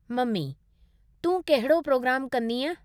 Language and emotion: Sindhi, neutral